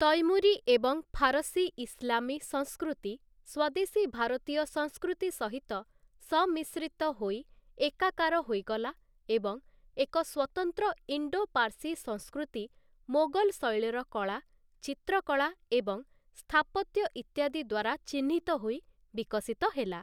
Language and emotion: Odia, neutral